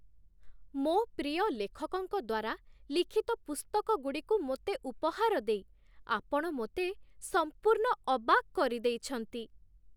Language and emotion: Odia, surprised